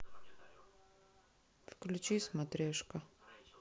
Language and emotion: Russian, neutral